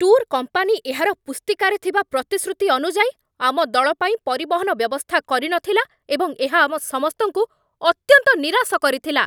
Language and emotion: Odia, angry